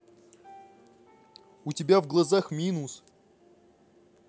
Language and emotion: Russian, neutral